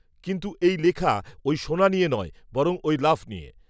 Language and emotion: Bengali, neutral